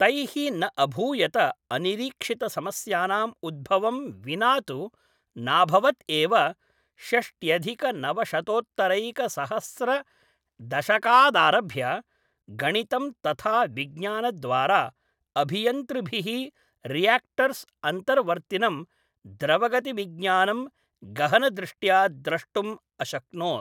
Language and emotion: Sanskrit, neutral